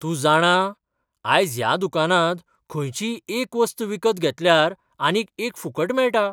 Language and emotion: Goan Konkani, surprised